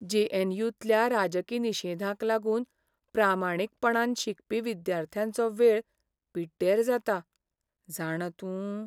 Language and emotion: Goan Konkani, sad